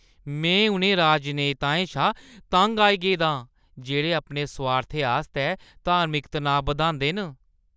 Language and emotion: Dogri, disgusted